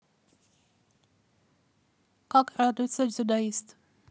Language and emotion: Russian, neutral